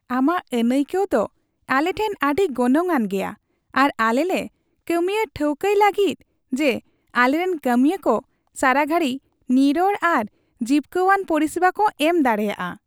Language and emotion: Santali, happy